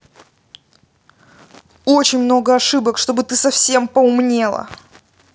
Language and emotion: Russian, angry